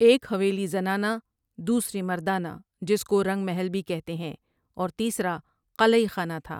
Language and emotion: Urdu, neutral